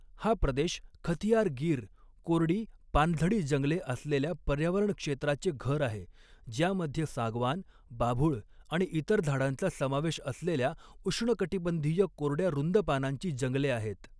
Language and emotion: Marathi, neutral